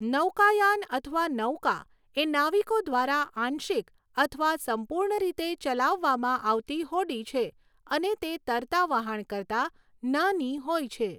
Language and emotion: Gujarati, neutral